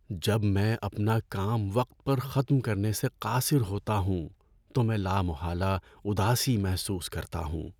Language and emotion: Urdu, sad